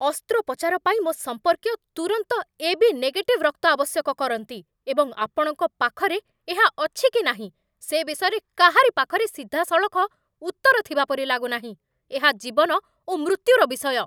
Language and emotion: Odia, angry